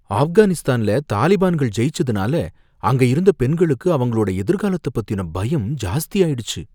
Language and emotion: Tamil, fearful